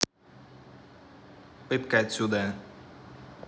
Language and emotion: Russian, angry